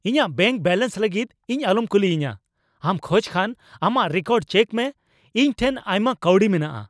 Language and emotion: Santali, angry